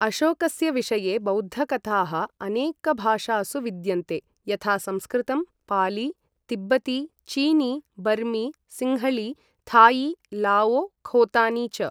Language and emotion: Sanskrit, neutral